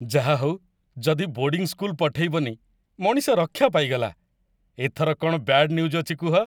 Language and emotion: Odia, happy